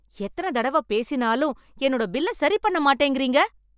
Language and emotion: Tamil, angry